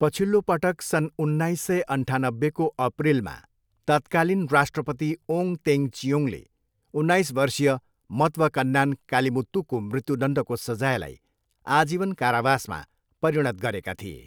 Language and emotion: Nepali, neutral